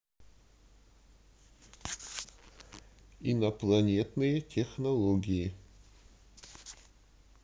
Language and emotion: Russian, neutral